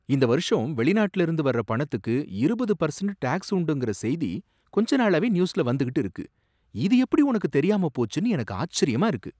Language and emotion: Tamil, surprised